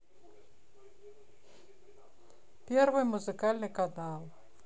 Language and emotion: Russian, neutral